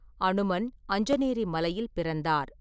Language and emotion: Tamil, neutral